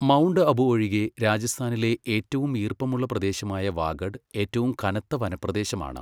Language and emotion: Malayalam, neutral